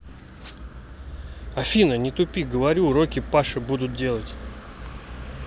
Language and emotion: Russian, neutral